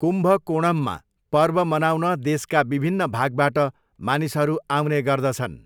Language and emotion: Nepali, neutral